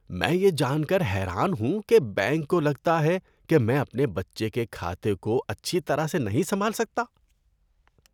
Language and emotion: Urdu, disgusted